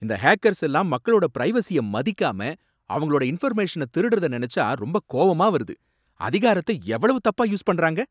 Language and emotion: Tamil, angry